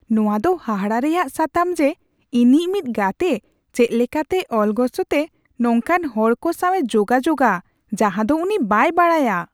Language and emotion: Santali, surprised